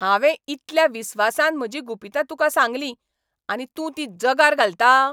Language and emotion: Goan Konkani, angry